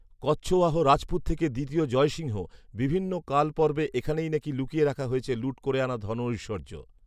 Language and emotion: Bengali, neutral